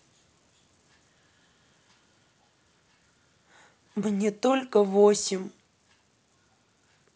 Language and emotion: Russian, sad